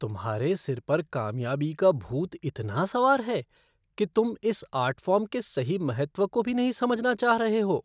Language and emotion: Hindi, disgusted